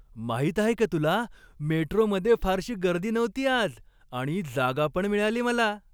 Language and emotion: Marathi, happy